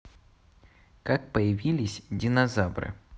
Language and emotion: Russian, neutral